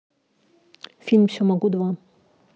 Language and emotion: Russian, neutral